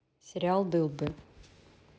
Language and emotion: Russian, neutral